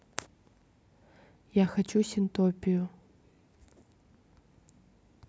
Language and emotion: Russian, neutral